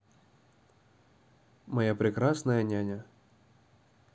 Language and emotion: Russian, neutral